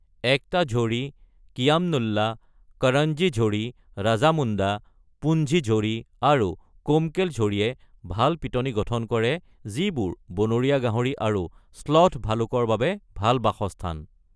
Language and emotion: Assamese, neutral